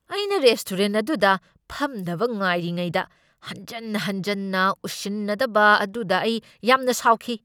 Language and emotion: Manipuri, angry